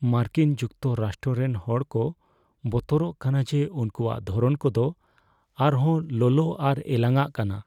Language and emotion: Santali, fearful